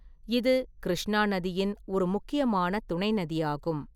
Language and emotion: Tamil, neutral